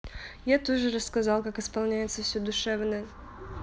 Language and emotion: Russian, neutral